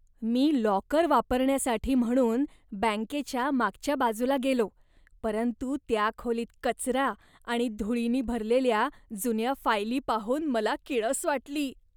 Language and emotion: Marathi, disgusted